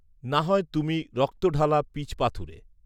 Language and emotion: Bengali, neutral